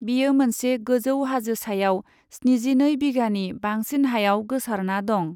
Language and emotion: Bodo, neutral